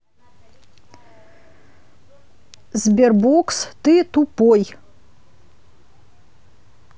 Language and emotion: Russian, neutral